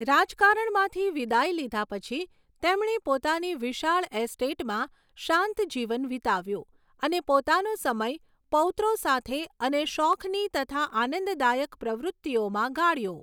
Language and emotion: Gujarati, neutral